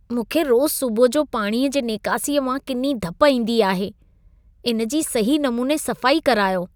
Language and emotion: Sindhi, disgusted